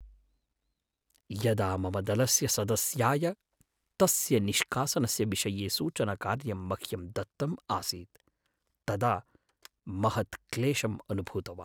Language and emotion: Sanskrit, sad